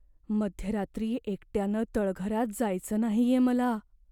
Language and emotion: Marathi, fearful